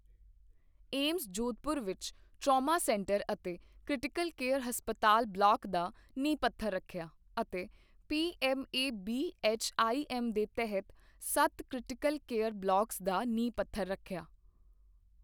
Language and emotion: Punjabi, neutral